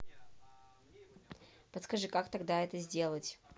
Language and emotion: Russian, neutral